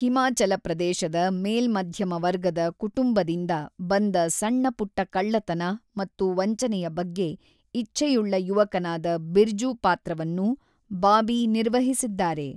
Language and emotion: Kannada, neutral